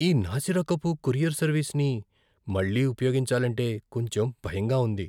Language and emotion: Telugu, fearful